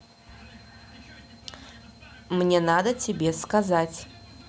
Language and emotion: Russian, neutral